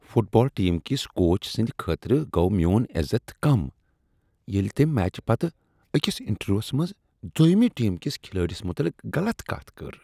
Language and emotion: Kashmiri, disgusted